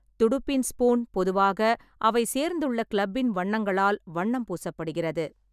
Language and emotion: Tamil, neutral